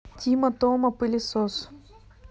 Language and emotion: Russian, neutral